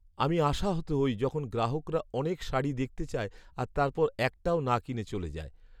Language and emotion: Bengali, sad